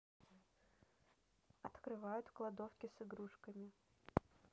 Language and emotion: Russian, neutral